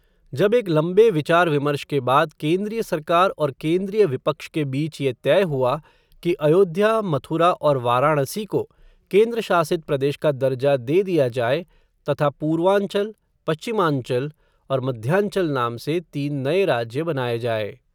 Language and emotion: Hindi, neutral